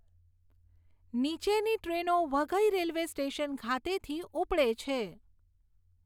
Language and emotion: Gujarati, neutral